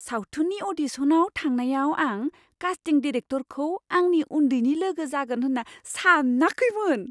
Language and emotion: Bodo, surprised